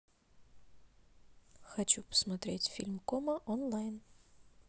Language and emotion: Russian, neutral